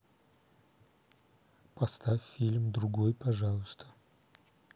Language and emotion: Russian, neutral